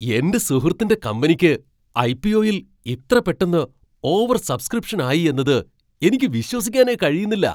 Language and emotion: Malayalam, surprised